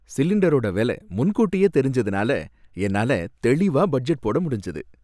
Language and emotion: Tamil, happy